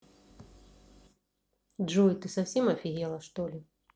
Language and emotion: Russian, neutral